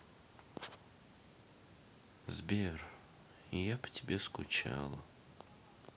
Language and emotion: Russian, sad